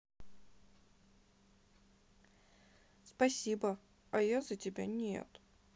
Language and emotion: Russian, sad